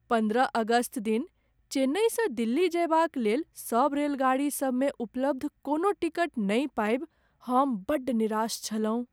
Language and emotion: Maithili, sad